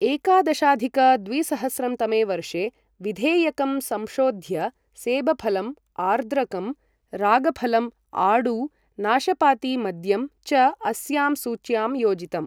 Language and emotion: Sanskrit, neutral